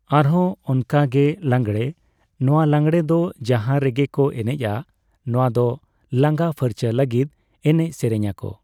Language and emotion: Santali, neutral